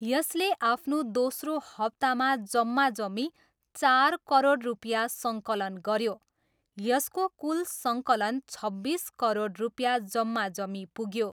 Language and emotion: Nepali, neutral